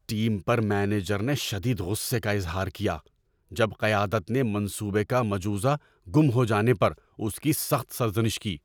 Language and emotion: Urdu, angry